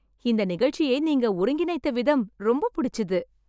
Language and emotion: Tamil, happy